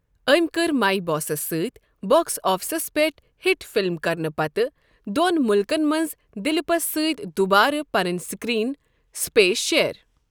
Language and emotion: Kashmiri, neutral